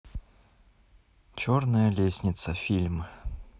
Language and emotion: Russian, neutral